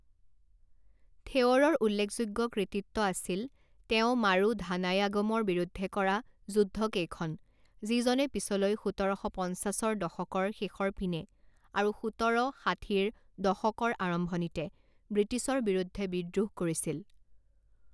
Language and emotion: Assamese, neutral